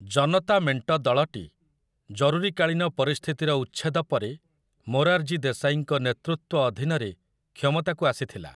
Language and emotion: Odia, neutral